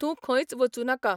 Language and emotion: Goan Konkani, neutral